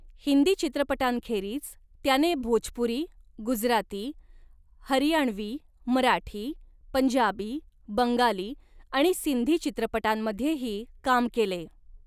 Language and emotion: Marathi, neutral